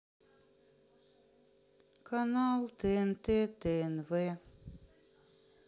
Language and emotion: Russian, sad